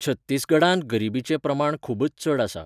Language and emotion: Goan Konkani, neutral